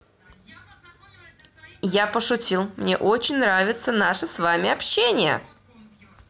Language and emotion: Russian, positive